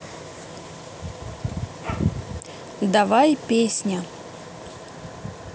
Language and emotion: Russian, neutral